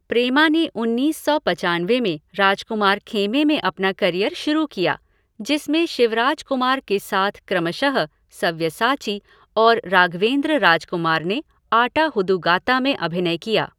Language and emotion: Hindi, neutral